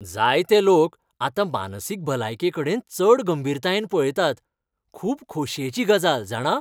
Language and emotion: Goan Konkani, happy